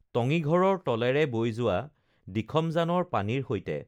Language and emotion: Assamese, neutral